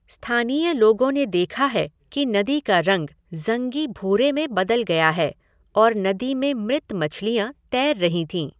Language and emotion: Hindi, neutral